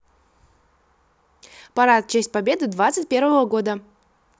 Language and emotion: Russian, neutral